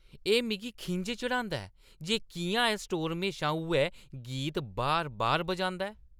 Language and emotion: Dogri, angry